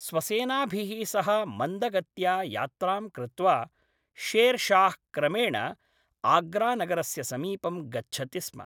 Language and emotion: Sanskrit, neutral